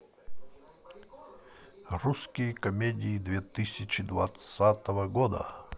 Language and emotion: Russian, positive